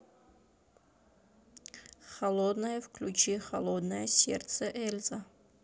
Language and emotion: Russian, neutral